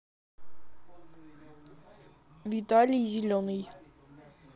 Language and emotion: Russian, neutral